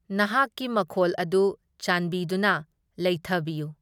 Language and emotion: Manipuri, neutral